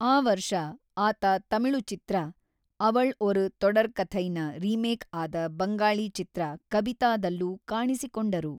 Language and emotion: Kannada, neutral